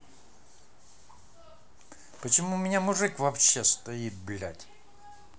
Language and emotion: Russian, angry